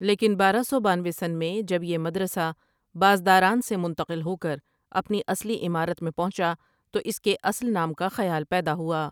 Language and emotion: Urdu, neutral